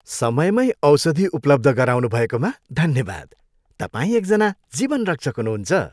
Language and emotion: Nepali, happy